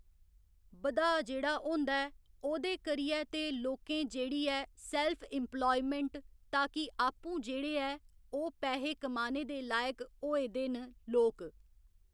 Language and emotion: Dogri, neutral